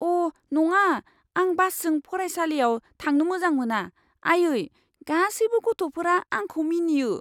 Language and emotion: Bodo, fearful